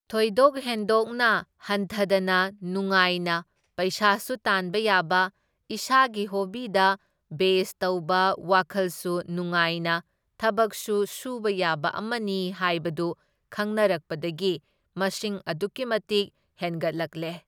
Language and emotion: Manipuri, neutral